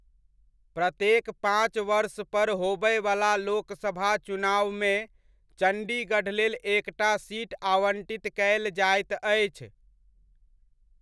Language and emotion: Maithili, neutral